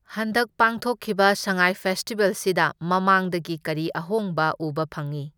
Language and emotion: Manipuri, neutral